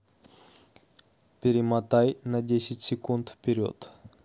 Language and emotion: Russian, neutral